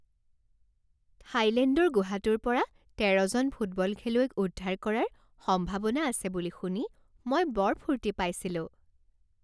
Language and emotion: Assamese, happy